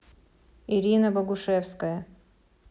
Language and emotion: Russian, neutral